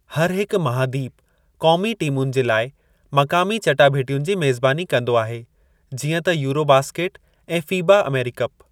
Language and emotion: Sindhi, neutral